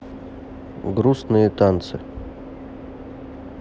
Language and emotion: Russian, neutral